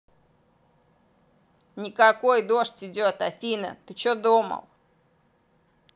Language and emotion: Russian, angry